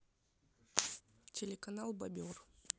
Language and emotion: Russian, neutral